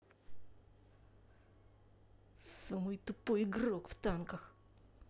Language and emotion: Russian, angry